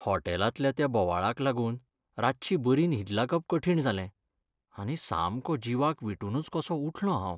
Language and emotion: Goan Konkani, sad